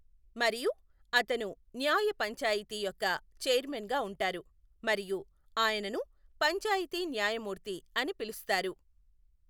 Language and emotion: Telugu, neutral